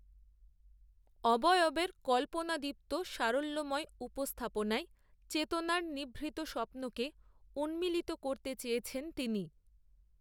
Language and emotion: Bengali, neutral